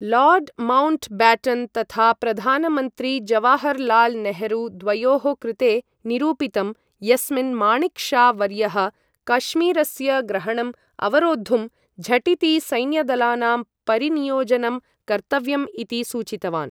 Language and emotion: Sanskrit, neutral